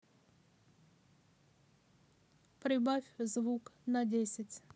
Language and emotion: Russian, neutral